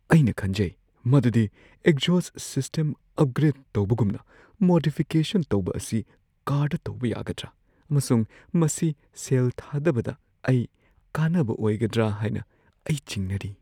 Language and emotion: Manipuri, fearful